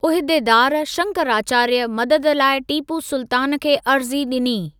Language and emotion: Sindhi, neutral